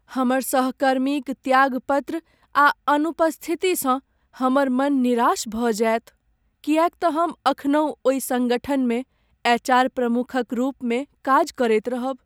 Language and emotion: Maithili, sad